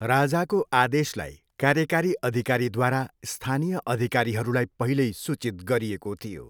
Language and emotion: Nepali, neutral